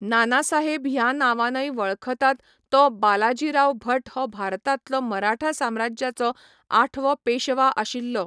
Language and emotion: Goan Konkani, neutral